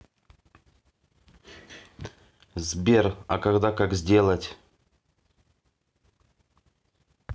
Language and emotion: Russian, neutral